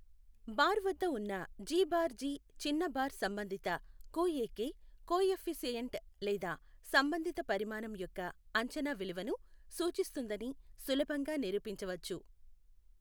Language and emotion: Telugu, neutral